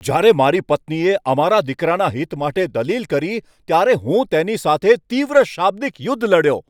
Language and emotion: Gujarati, angry